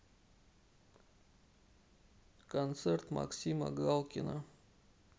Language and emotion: Russian, sad